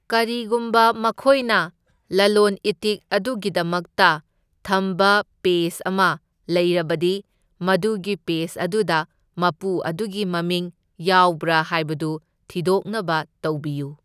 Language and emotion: Manipuri, neutral